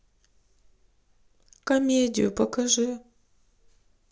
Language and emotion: Russian, sad